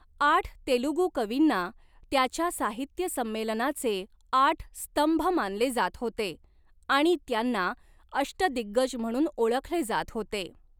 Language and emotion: Marathi, neutral